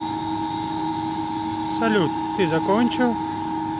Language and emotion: Russian, neutral